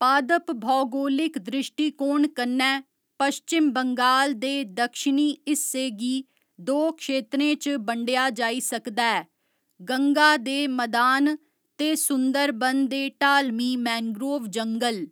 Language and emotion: Dogri, neutral